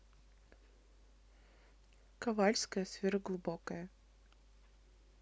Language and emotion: Russian, neutral